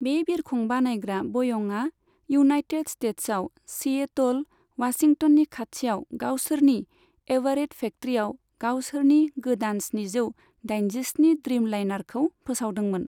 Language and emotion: Bodo, neutral